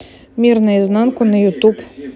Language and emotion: Russian, neutral